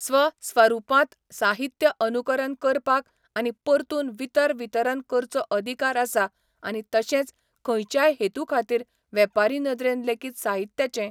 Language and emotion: Goan Konkani, neutral